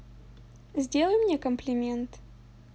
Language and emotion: Russian, positive